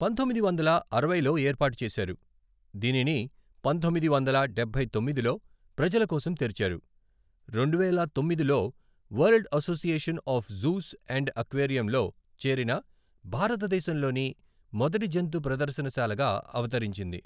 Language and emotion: Telugu, neutral